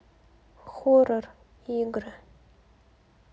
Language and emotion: Russian, sad